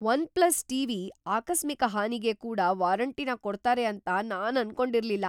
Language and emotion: Kannada, surprised